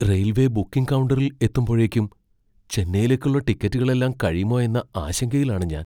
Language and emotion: Malayalam, fearful